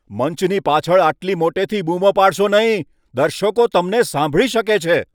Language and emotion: Gujarati, angry